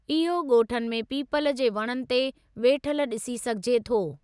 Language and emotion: Sindhi, neutral